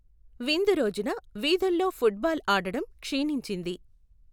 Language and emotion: Telugu, neutral